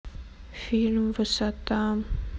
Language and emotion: Russian, sad